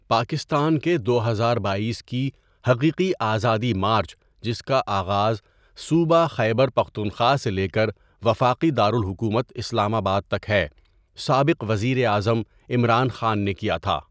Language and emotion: Urdu, neutral